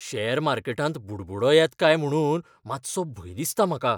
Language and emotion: Goan Konkani, fearful